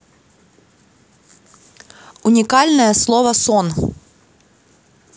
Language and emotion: Russian, positive